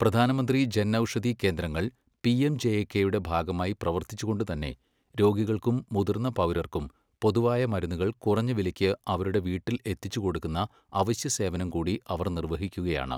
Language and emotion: Malayalam, neutral